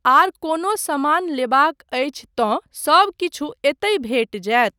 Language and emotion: Maithili, neutral